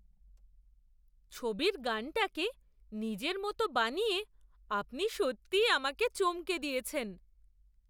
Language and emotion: Bengali, surprised